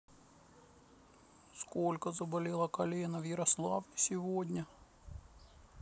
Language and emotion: Russian, sad